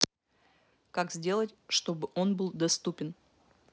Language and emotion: Russian, neutral